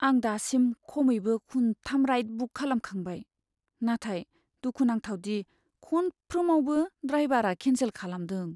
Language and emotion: Bodo, sad